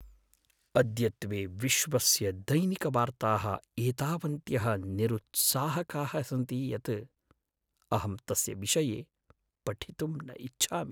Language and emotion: Sanskrit, sad